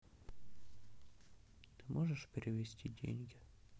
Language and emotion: Russian, sad